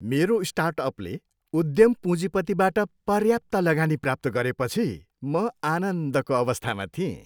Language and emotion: Nepali, happy